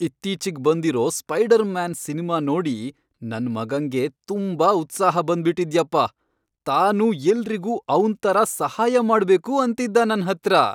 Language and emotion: Kannada, happy